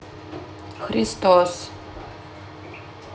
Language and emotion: Russian, neutral